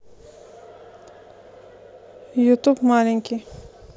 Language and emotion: Russian, neutral